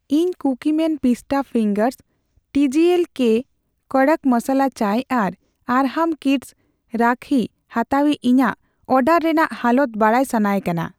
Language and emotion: Santali, neutral